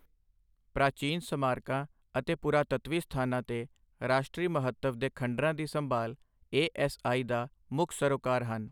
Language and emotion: Punjabi, neutral